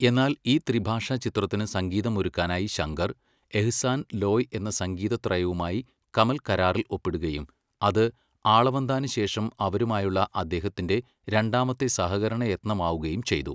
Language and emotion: Malayalam, neutral